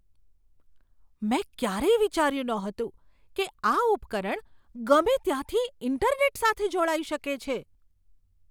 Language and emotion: Gujarati, surprised